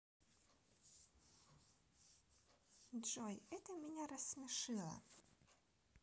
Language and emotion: Russian, positive